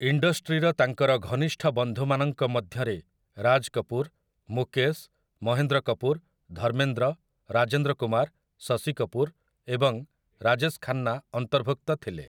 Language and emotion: Odia, neutral